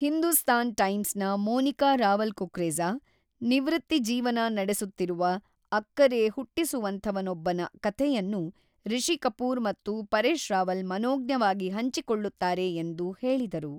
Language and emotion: Kannada, neutral